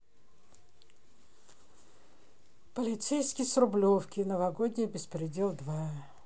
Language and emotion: Russian, sad